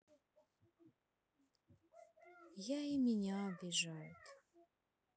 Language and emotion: Russian, sad